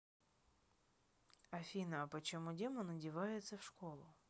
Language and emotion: Russian, neutral